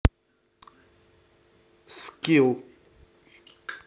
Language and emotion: Russian, neutral